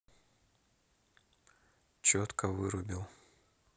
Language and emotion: Russian, neutral